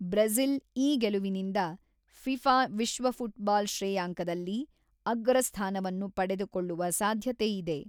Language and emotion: Kannada, neutral